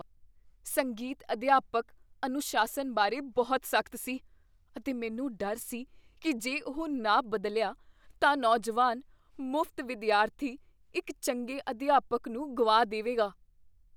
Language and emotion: Punjabi, fearful